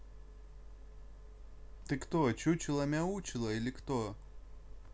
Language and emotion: Russian, neutral